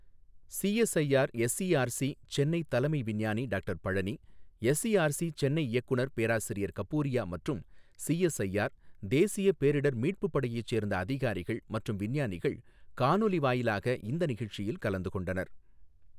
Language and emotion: Tamil, neutral